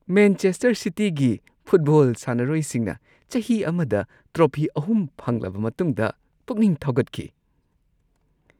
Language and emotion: Manipuri, happy